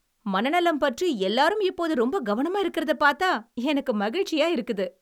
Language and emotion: Tamil, happy